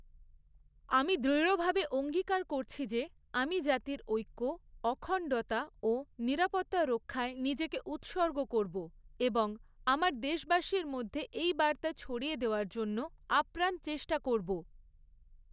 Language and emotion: Bengali, neutral